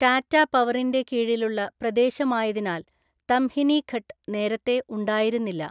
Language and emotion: Malayalam, neutral